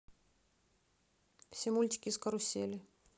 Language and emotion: Russian, neutral